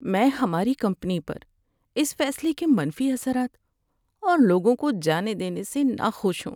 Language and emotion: Urdu, sad